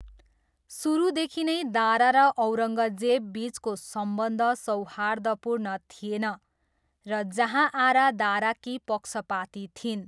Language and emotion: Nepali, neutral